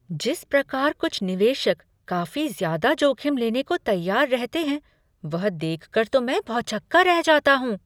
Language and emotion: Hindi, surprised